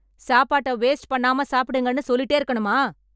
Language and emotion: Tamil, angry